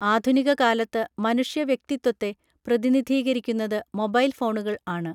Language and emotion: Malayalam, neutral